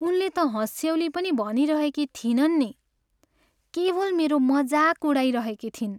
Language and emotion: Nepali, sad